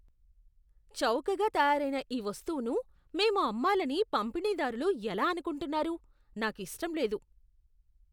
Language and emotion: Telugu, disgusted